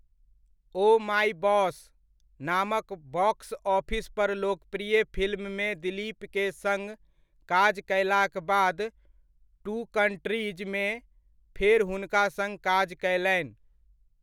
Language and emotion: Maithili, neutral